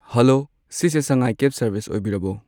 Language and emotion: Manipuri, neutral